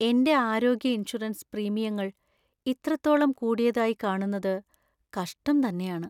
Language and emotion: Malayalam, sad